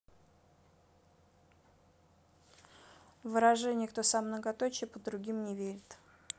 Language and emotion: Russian, neutral